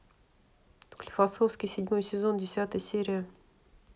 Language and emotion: Russian, neutral